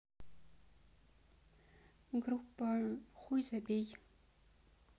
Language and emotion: Russian, neutral